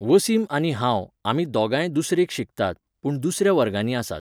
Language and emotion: Goan Konkani, neutral